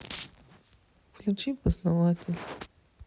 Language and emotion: Russian, sad